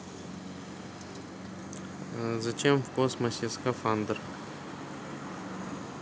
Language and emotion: Russian, neutral